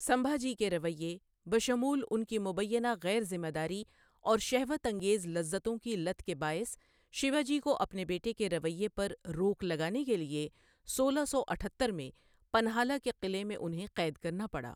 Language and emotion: Urdu, neutral